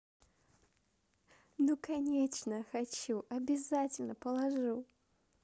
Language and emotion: Russian, positive